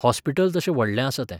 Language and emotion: Goan Konkani, neutral